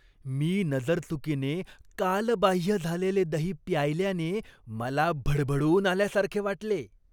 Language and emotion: Marathi, disgusted